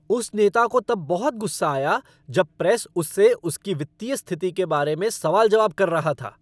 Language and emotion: Hindi, angry